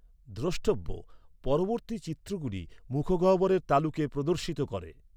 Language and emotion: Bengali, neutral